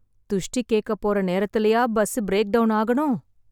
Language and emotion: Tamil, sad